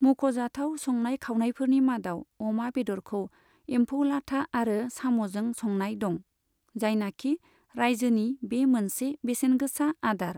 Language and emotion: Bodo, neutral